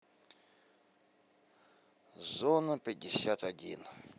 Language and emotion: Russian, neutral